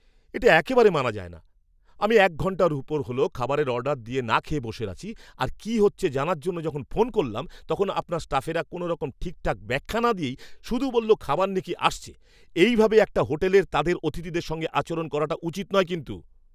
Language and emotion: Bengali, angry